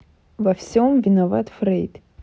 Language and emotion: Russian, neutral